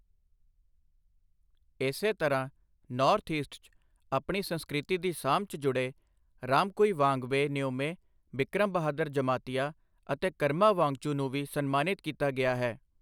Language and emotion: Punjabi, neutral